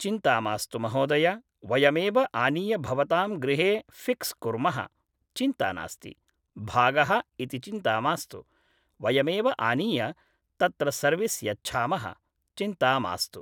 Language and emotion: Sanskrit, neutral